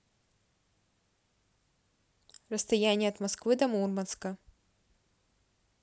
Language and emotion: Russian, neutral